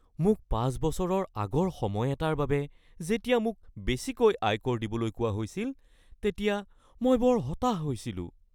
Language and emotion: Assamese, fearful